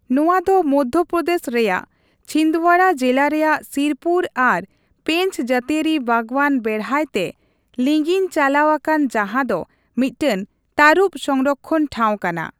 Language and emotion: Santali, neutral